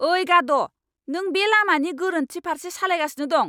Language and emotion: Bodo, angry